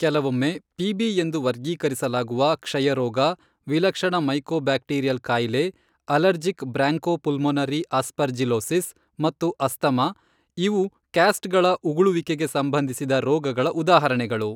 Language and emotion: Kannada, neutral